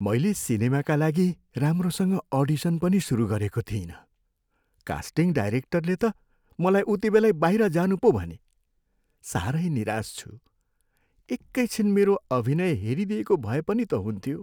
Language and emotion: Nepali, sad